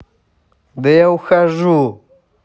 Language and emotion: Russian, angry